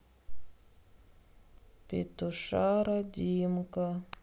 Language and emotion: Russian, sad